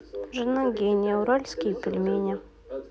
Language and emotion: Russian, neutral